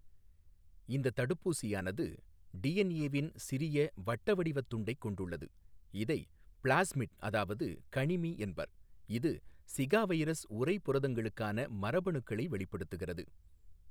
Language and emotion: Tamil, neutral